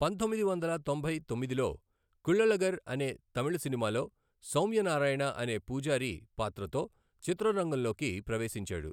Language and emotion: Telugu, neutral